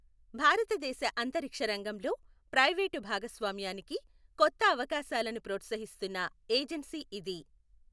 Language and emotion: Telugu, neutral